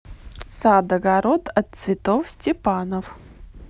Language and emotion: Russian, neutral